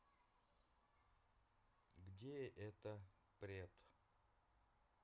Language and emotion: Russian, neutral